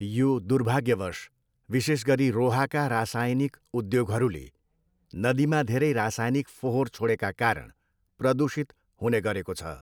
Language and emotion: Nepali, neutral